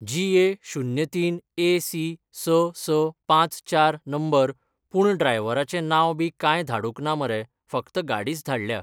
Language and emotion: Goan Konkani, neutral